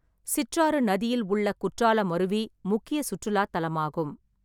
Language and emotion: Tamil, neutral